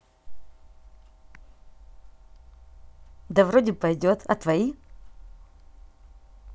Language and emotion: Russian, positive